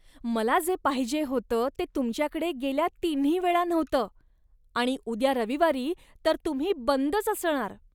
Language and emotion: Marathi, disgusted